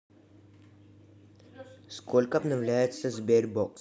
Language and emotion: Russian, neutral